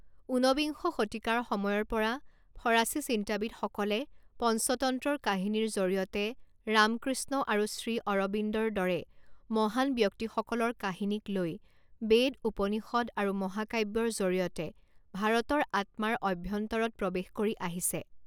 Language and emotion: Assamese, neutral